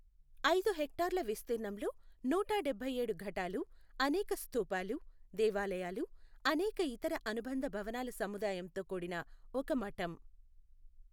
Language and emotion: Telugu, neutral